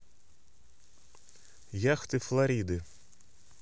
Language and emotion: Russian, neutral